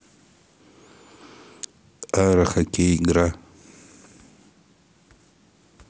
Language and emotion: Russian, neutral